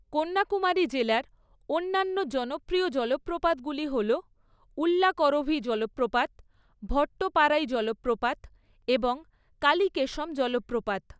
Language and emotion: Bengali, neutral